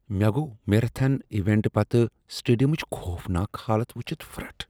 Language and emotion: Kashmiri, disgusted